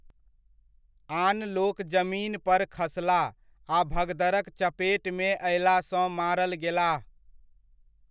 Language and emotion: Maithili, neutral